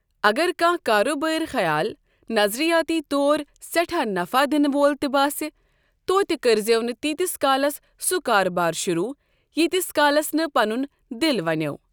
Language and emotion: Kashmiri, neutral